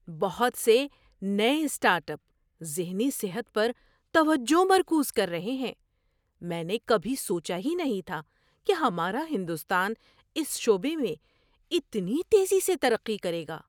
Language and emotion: Urdu, surprised